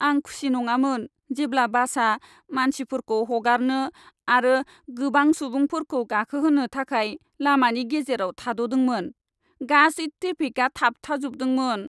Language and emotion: Bodo, sad